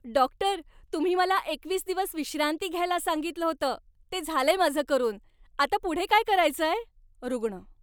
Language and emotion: Marathi, happy